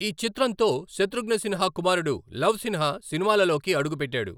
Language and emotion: Telugu, neutral